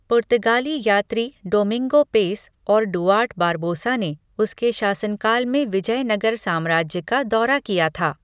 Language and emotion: Hindi, neutral